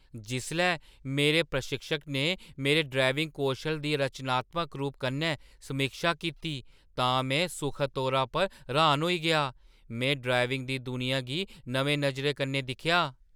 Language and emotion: Dogri, surprised